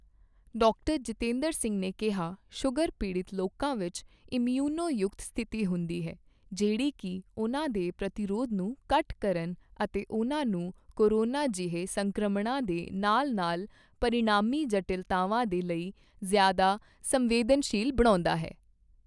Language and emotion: Punjabi, neutral